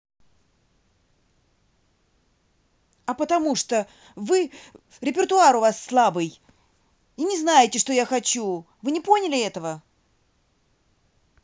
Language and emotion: Russian, angry